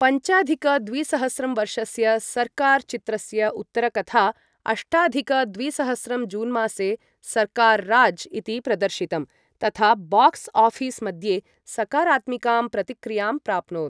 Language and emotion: Sanskrit, neutral